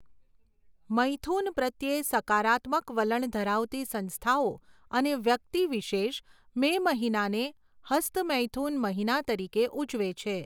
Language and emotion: Gujarati, neutral